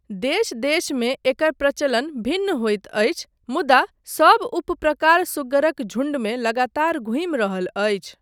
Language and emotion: Maithili, neutral